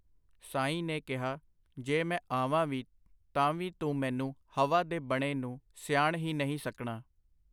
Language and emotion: Punjabi, neutral